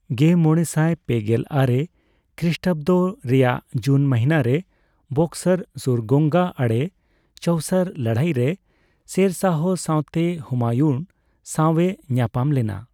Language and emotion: Santali, neutral